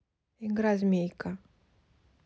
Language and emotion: Russian, neutral